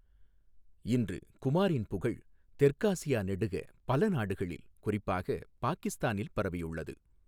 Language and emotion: Tamil, neutral